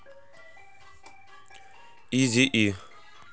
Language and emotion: Russian, neutral